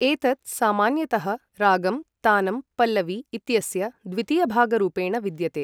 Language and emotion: Sanskrit, neutral